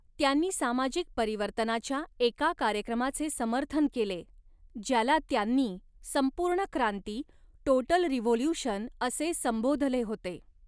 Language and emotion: Marathi, neutral